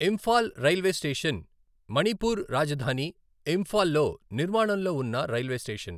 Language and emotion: Telugu, neutral